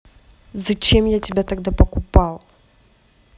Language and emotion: Russian, angry